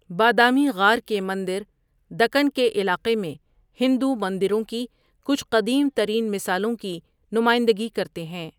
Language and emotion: Urdu, neutral